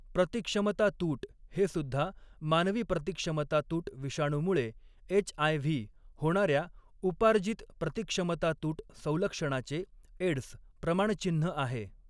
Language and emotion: Marathi, neutral